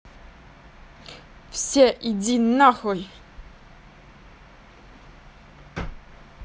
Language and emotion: Russian, angry